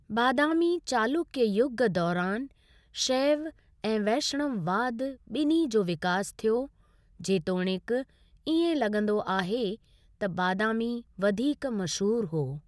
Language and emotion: Sindhi, neutral